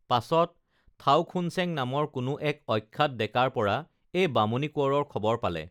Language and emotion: Assamese, neutral